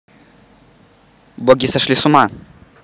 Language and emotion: Russian, neutral